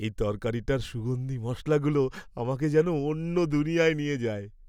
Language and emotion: Bengali, happy